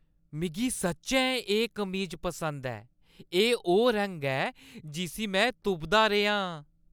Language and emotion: Dogri, happy